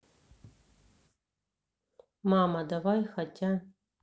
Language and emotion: Russian, neutral